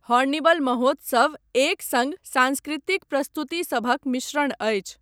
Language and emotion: Maithili, neutral